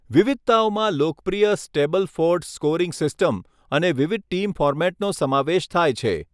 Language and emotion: Gujarati, neutral